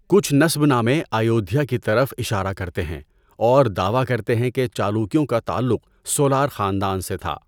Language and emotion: Urdu, neutral